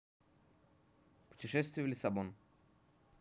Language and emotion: Russian, neutral